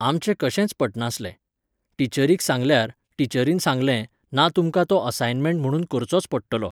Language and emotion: Goan Konkani, neutral